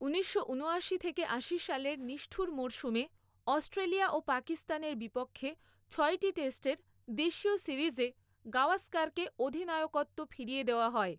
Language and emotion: Bengali, neutral